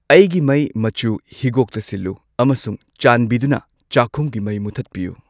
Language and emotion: Manipuri, neutral